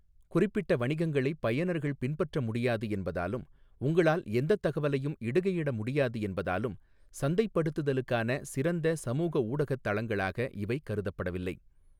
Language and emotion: Tamil, neutral